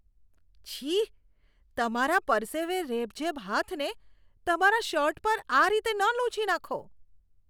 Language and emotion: Gujarati, disgusted